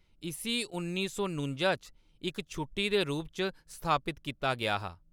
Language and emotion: Dogri, neutral